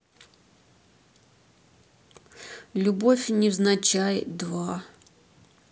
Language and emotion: Russian, neutral